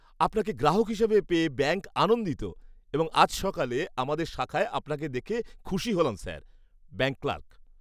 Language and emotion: Bengali, happy